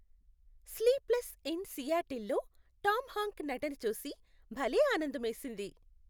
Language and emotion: Telugu, happy